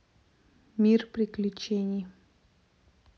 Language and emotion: Russian, neutral